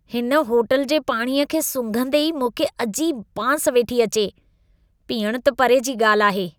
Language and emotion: Sindhi, disgusted